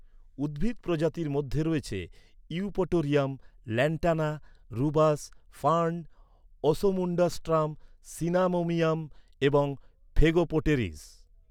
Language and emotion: Bengali, neutral